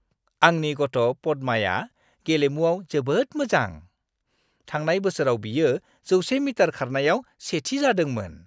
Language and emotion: Bodo, happy